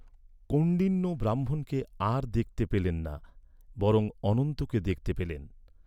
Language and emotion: Bengali, neutral